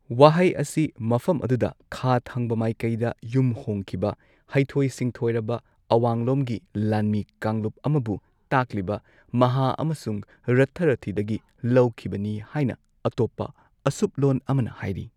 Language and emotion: Manipuri, neutral